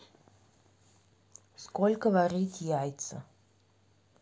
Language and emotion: Russian, neutral